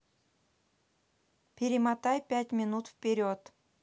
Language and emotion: Russian, neutral